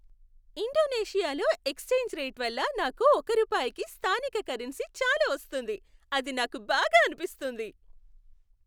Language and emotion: Telugu, happy